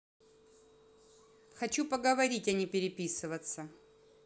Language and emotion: Russian, neutral